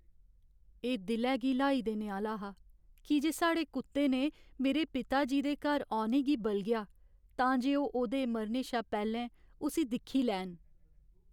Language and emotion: Dogri, sad